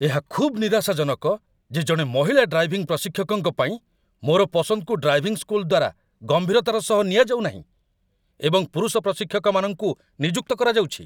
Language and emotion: Odia, angry